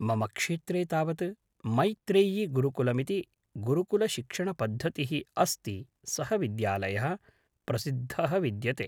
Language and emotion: Sanskrit, neutral